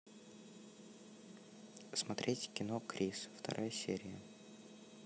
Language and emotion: Russian, neutral